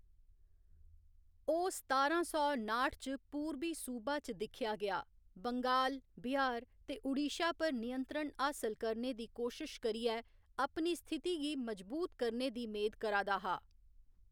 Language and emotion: Dogri, neutral